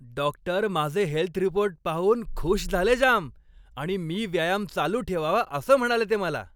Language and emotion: Marathi, happy